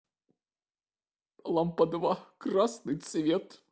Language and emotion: Russian, sad